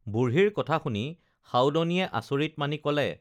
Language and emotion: Assamese, neutral